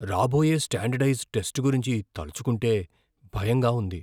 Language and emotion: Telugu, fearful